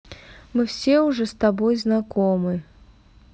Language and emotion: Russian, neutral